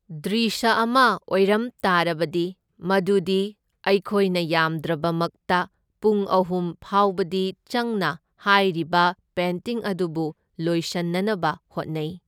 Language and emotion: Manipuri, neutral